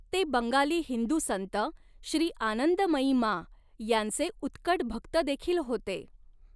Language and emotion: Marathi, neutral